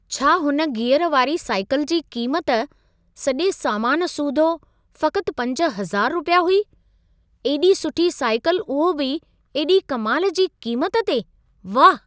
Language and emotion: Sindhi, surprised